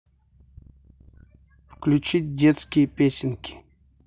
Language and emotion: Russian, neutral